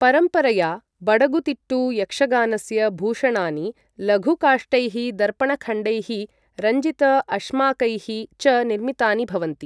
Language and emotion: Sanskrit, neutral